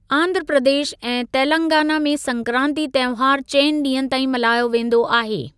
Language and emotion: Sindhi, neutral